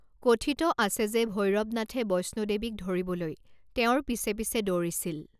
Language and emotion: Assamese, neutral